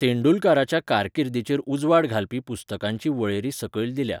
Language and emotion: Goan Konkani, neutral